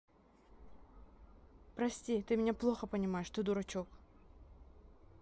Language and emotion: Russian, neutral